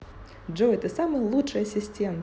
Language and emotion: Russian, positive